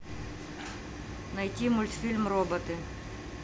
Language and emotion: Russian, neutral